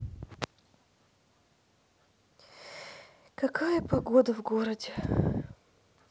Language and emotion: Russian, sad